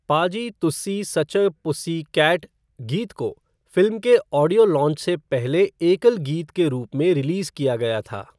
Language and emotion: Hindi, neutral